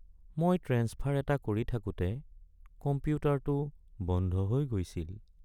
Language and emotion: Assamese, sad